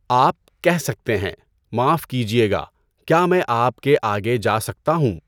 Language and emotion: Urdu, neutral